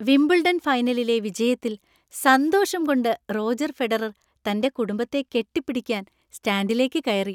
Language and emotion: Malayalam, happy